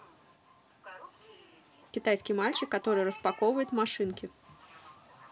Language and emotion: Russian, positive